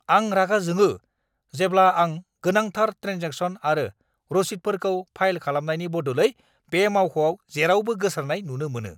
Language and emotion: Bodo, angry